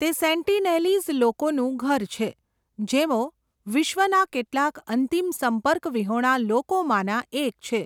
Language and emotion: Gujarati, neutral